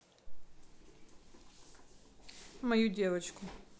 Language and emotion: Russian, neutral